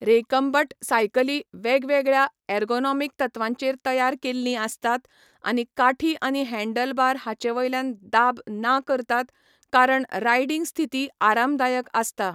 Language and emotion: Goan Konkani, neutral